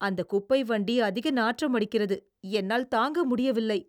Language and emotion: Tamil, disgusted